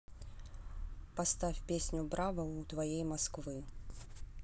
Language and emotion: Russian, neutral